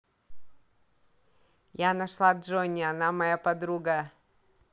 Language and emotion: Russian, positive